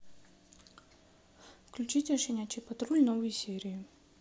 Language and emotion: Russian, neutral